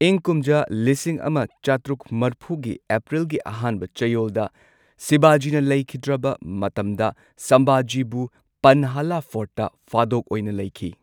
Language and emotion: Manipuri, neutral